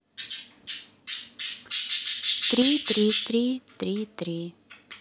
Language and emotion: Russian, neutral